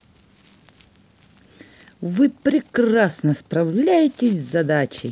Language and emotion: Russian, positive